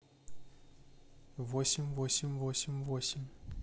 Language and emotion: Russian, neutral